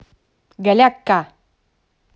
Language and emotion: Russian, neutral